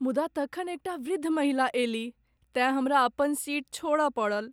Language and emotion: Maithili, sad